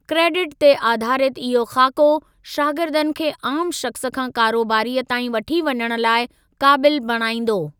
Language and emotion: Sindhi, neutral